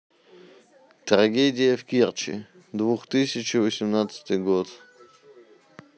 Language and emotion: Russian, neutral